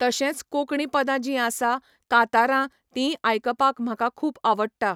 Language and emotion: Goan Konkani, neutral